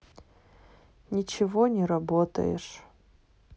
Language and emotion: Russian, sad